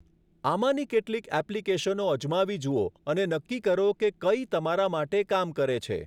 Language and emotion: Gujarati, neutral